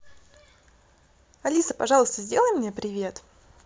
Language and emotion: Russian, positive